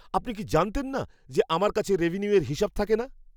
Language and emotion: Bengali, surprised